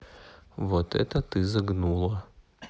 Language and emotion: Russian, neutral